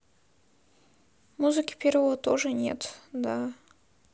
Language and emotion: Russian, sad